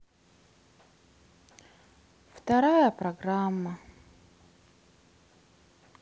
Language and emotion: Russian, sad